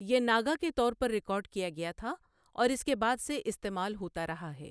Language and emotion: Urdu, neutral